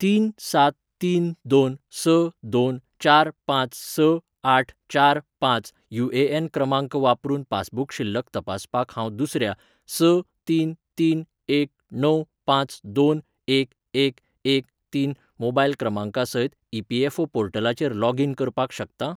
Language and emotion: Goan Konkani, neutral